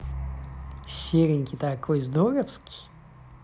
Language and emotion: Russian, positive